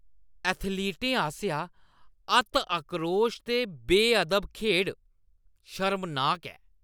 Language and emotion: Dogri, disgusted